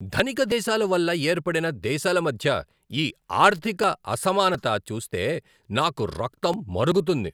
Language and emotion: Telugu, angry